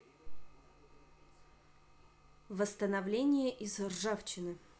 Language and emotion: Russian, neutral